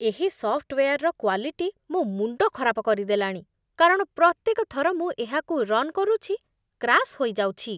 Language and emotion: Odia, disgusted